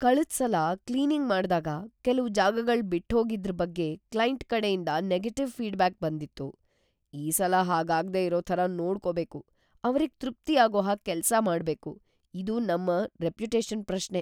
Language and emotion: Kannada, fearful